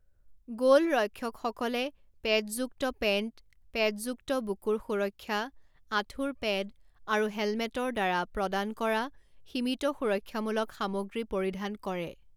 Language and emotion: Assamese, neutral